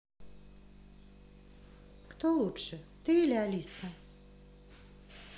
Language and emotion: Russian, neutral